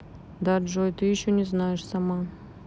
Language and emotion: Russian, neutral